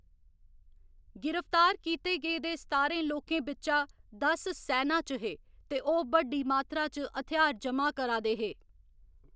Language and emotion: Dogri, neutral